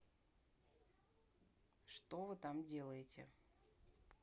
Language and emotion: Russian, neutral